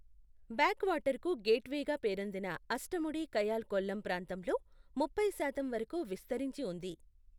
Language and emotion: Telugu, neutral